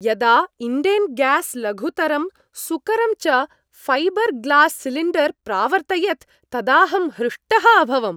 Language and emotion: Sanskrit, happy